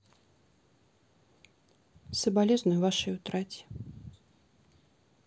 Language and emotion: Russian, sad